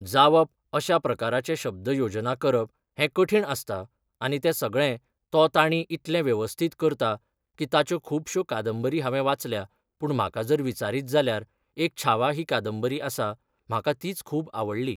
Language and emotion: Goan Konkani, neutral